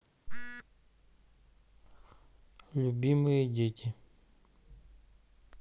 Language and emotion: Russian, neutral